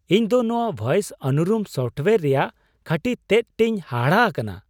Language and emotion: Santali, surprised